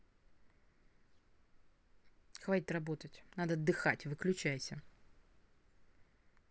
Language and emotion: Russian, angry